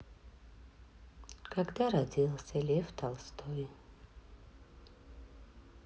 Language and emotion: Russian, sad